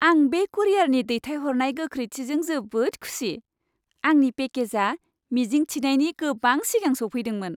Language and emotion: Bodo, happy